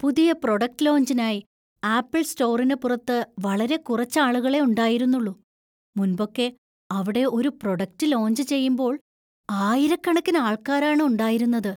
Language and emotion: Malayalam, surprised